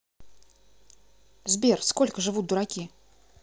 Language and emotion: Russian, neutral